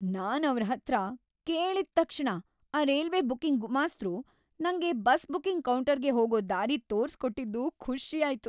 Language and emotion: Kannada, happy